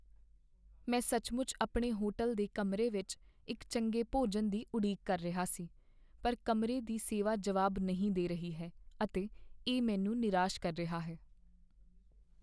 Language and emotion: Punjabi, sad